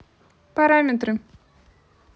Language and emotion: Russian, neutral